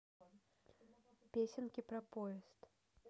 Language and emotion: Russian, neutral